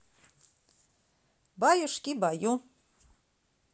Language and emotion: Russian, positive